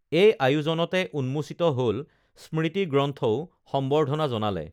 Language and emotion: Assamese, neutral